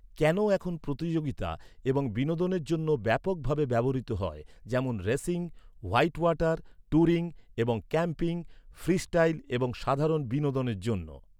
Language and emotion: Bengali, neutral